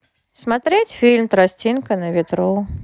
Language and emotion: Russian, neutral